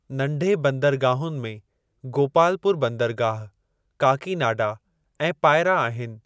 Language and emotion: Sindhi, neutral